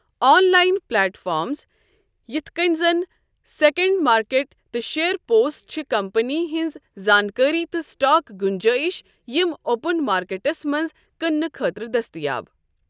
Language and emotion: Kashmiri, neutral